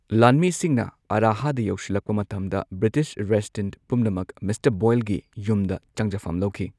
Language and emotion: Manipuri, neutral